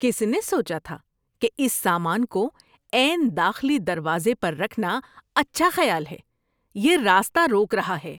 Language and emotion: Urdu, disgusted